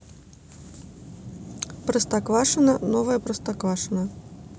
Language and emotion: Russian, neutral